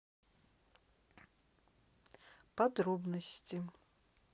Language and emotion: Russian, neutral